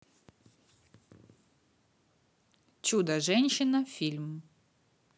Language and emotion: Russian, positive